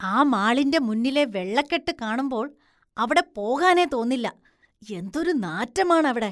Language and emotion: Malayalam, disgusted